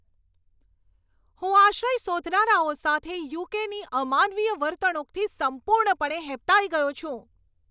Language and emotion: Gujarati, angry